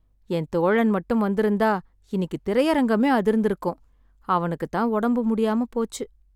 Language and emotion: Tamil, sad